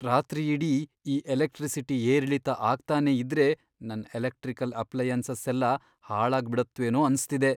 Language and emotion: Kannada, fearful